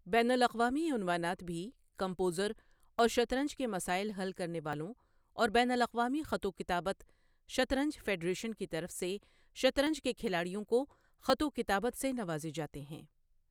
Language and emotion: Urdu, neutral